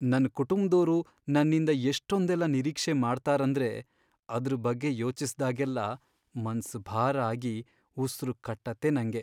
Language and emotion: Kannada, sad